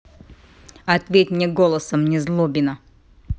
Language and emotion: Russian, angry